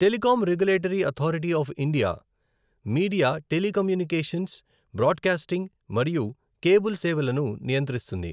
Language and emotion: Telugu, neutral